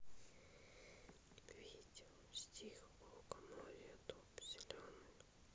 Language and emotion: Russian, neutral